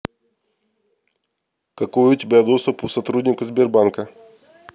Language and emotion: Russian, neutral